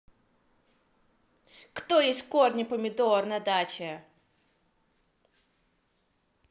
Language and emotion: Russian, angry